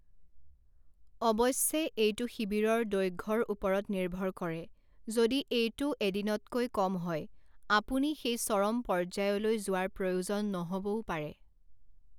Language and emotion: Assamese, neutral